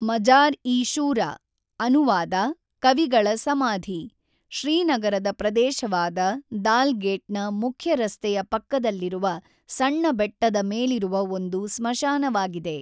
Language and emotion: Kannada, neutral